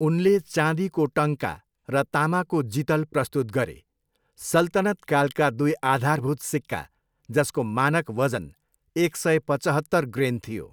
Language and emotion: Nepali, neutral